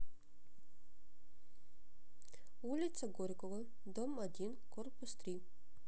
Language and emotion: Russian, neutral